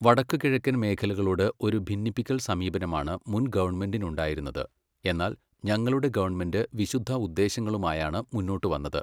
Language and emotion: Malayalam, neutral